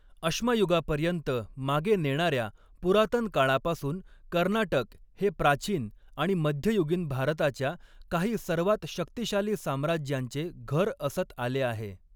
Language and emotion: Marathi, neutral